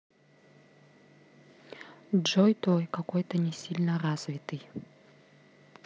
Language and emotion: Russian, neutral